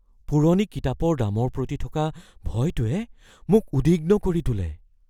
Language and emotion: Assamese, fearful